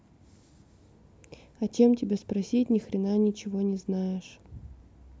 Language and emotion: Russian, neutral